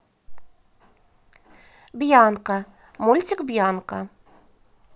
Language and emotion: Russian, positive